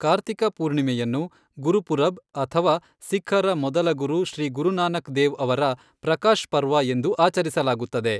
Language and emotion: Kannada, neutral